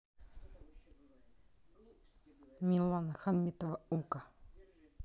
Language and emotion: Russian, neutral